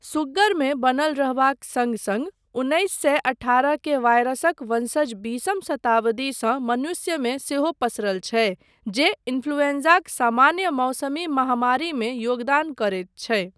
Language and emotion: Maithili, neutral